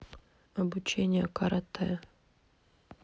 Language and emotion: Russian, neutral